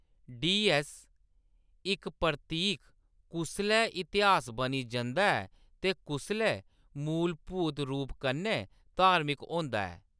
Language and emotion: Dogri, neutral